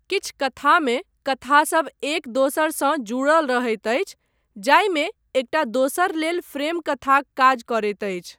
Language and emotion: Maithili, neutral